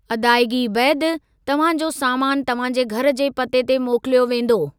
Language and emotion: Sindhi, neutral